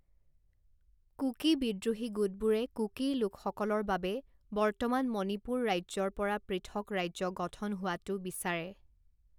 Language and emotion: Assamese, neutral